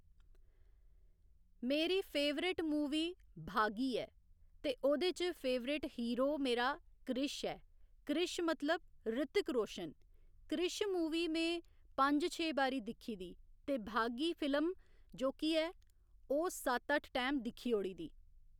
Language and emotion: Dogri, neutral